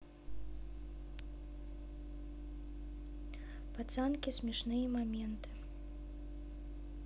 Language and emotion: Russian, neutral